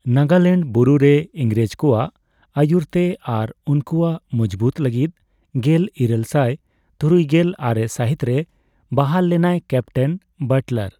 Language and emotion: Santali, neutral